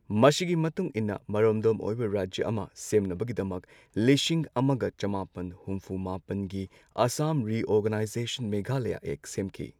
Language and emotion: Manipuri, neutral